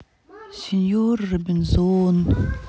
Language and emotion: Russian, sad